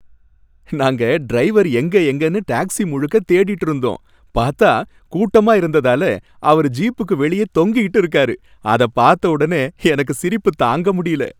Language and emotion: Tamil, happy